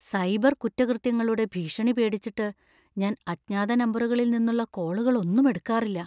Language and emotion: Malayalam, fearful